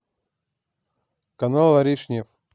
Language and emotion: Russian, neutral